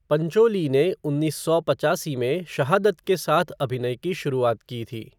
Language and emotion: Hindi, neutral